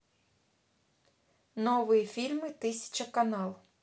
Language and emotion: Russian, neutral